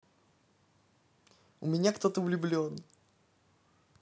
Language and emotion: Russian, positive